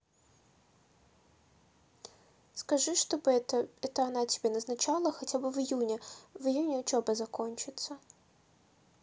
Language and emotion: Russian, neutral